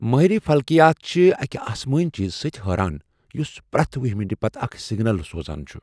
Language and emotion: Kashmiri, surprised